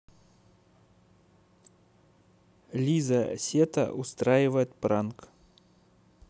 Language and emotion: Russian, neutral